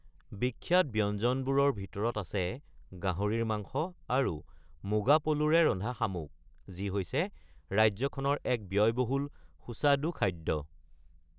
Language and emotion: Assamese, neutral